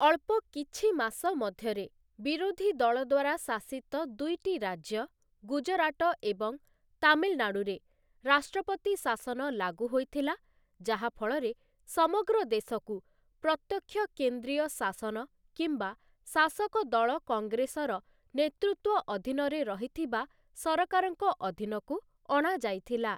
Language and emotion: Odia, neutral